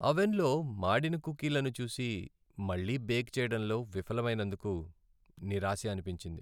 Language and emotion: Telugu, sad